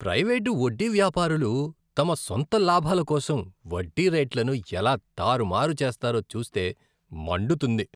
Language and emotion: Telugu, disgusted